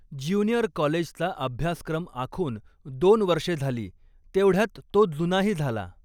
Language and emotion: Marathi, neutral